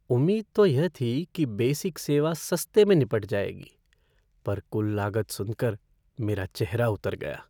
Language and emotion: Hindi, sad